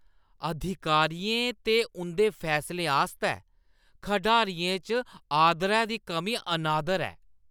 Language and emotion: Dogri, disgusted